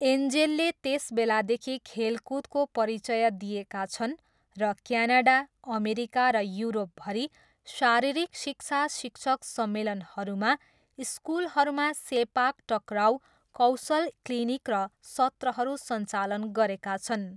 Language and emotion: Nepali, neutral